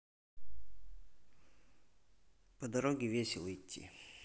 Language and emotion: Russian, neutral